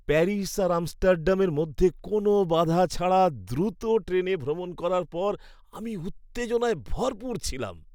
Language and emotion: Bengali, happy